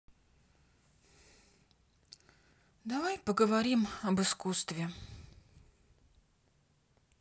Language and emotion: Russian, sad